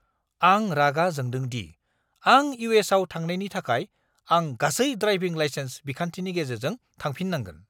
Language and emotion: Bodo, angry